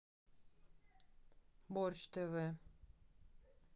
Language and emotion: Russian, neutral